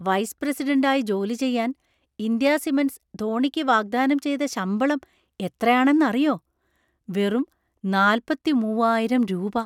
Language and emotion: Malayalam, surprised